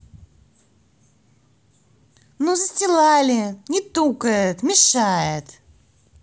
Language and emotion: Russian, angry